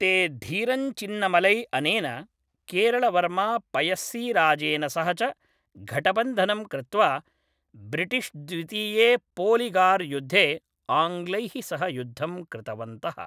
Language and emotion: Sanskrit, neutral